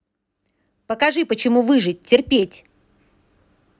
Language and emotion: Russian, angry